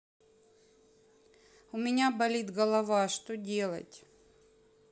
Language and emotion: Russian, sad